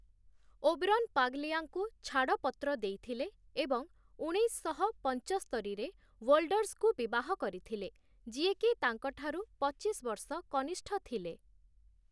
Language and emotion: Odia, neutral